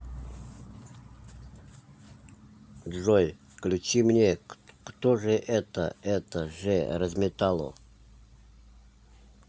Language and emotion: Russian, neutral